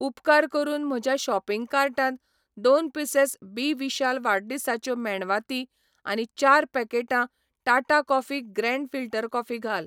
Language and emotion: Goan Konkani, neutral